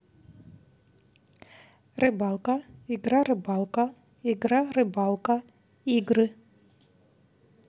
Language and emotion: Russian, neutral